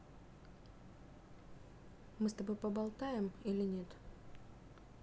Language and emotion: Russian, neutral